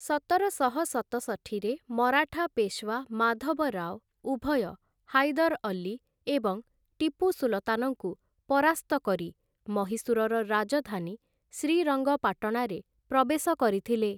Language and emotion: Odia, neutral